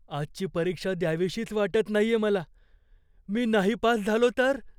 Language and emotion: Marathi, fearful